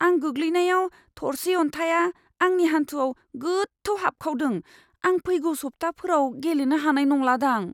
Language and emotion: Bodo, fearful